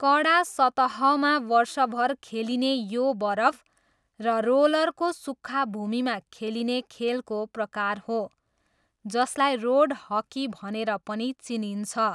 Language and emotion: Nepali, neutral